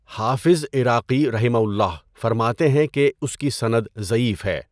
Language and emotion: Urdu, neutral